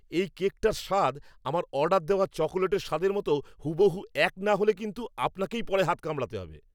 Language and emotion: Bengali, angry